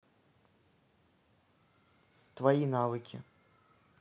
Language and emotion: Russian, neutral